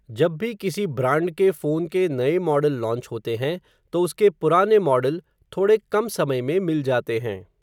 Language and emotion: Hindi, neutral